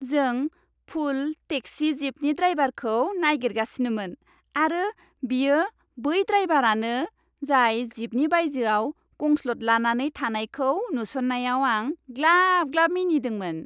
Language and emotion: Bodo, happy